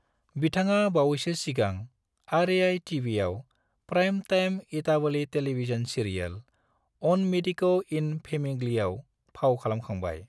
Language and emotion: Bodo, neutral